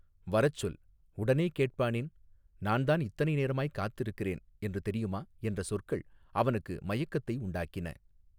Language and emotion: Tamil, neutral